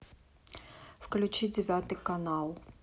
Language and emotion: Russian, neutral